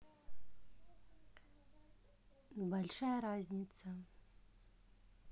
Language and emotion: Russian, neutral